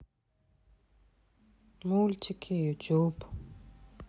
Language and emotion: Russian, sad